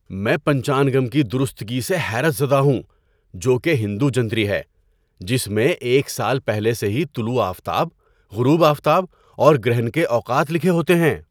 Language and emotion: Urdu, surprised